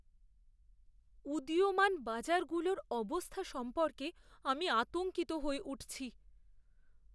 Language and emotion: Bengali, fearful